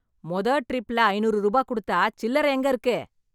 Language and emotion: Tamil, angry